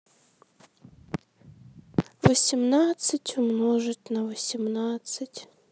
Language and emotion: Russian, sad